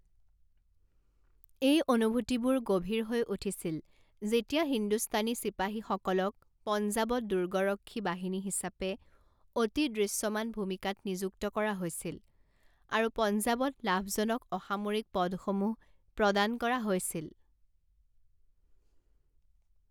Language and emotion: Assamese, neutral